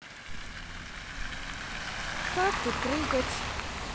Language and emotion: Russian, neutral